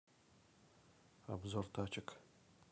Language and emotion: Russian, neutral